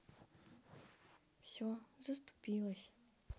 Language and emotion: Russian, sad